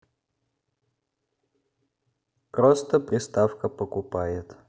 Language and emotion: Russian, neutral